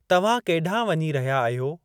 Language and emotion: Sindhi, neutral